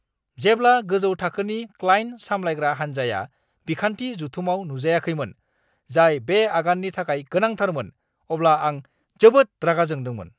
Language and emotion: Bodo, angry